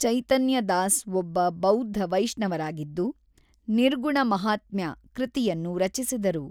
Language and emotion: Kannada, neutral